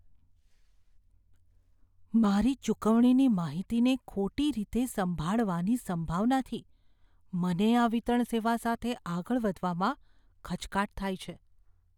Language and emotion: Gujarati, fearful